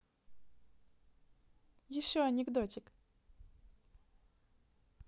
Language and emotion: Russian, positive